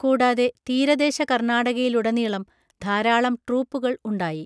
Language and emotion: Malayalam, neutral